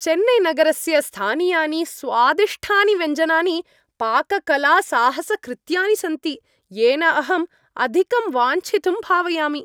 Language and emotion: Sanskrit, happy